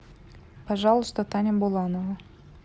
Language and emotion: Russian, neutral